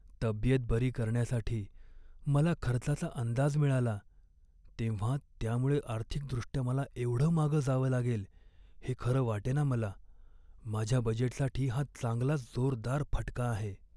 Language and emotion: Marathi, sad